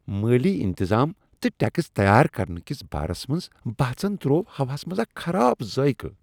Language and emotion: Kashmiri, disgusted